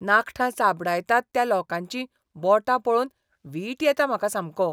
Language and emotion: Goan Konkani, disgusted